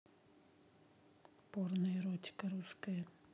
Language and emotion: Russian, neutral